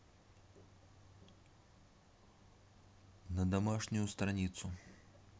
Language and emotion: Russian, neutral